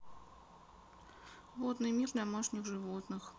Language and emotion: Russian, sad